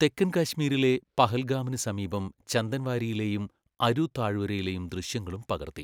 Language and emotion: Malayalam, neutral